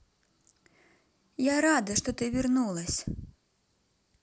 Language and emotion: Russian, neutral